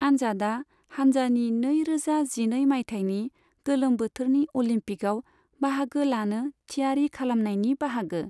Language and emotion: Bodo, neutral